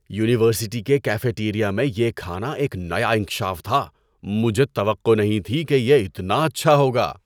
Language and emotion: Urdu, surprised